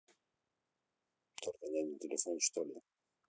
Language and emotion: Russian, neutral